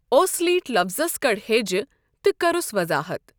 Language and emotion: Kashmiri, neutral